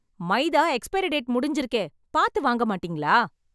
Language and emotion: Tamil, angry